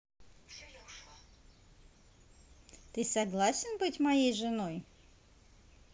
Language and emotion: Russian, positive